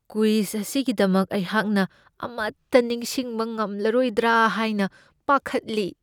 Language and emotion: Manipuri, fearful